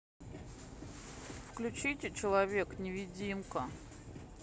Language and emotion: Russian, sad